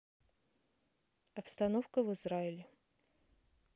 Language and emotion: Russian, neutral